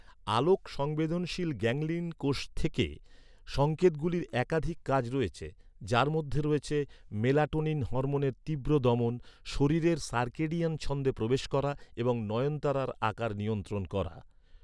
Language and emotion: Bengali, neutral